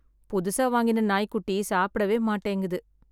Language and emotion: Tamil, sad